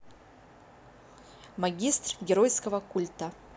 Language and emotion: Russian, positive